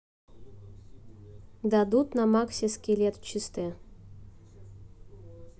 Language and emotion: Russian, neutral